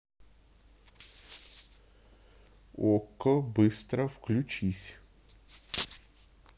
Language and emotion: Russian, neutral